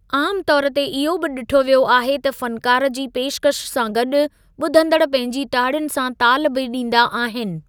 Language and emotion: Sindhi, neutral